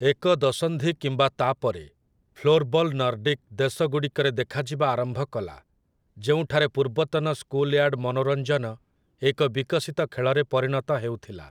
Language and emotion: Odia, neutral